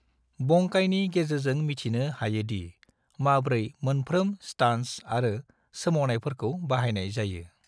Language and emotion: Bodo, neutral